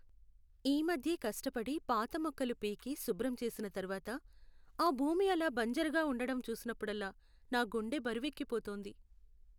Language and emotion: Telugu, sad